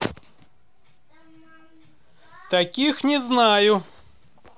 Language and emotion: Russian, positive